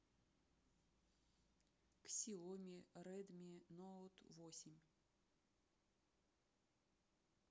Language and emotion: Russian, neutral